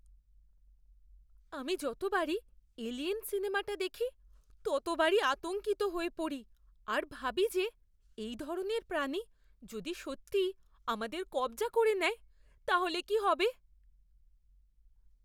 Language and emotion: Bengali, fearful